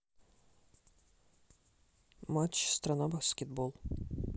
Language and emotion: Russian, neutral